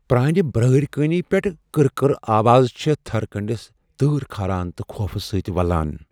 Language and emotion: Kashmiri, fearful